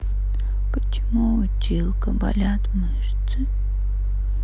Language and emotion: Russian, sad